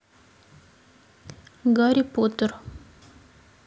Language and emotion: Russian, neutral